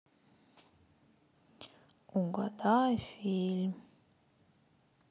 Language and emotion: Russian, sad